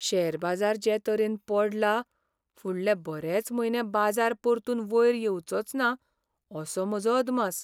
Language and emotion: Goan Konkani, sad